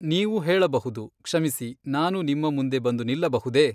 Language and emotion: Kannada, neutral